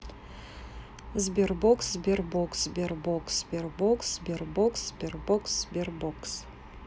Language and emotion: Russian, neutral